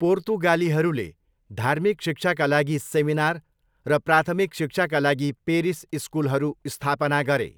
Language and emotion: Nepali, neutral